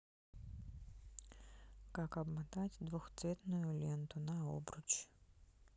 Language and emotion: Russian, neutral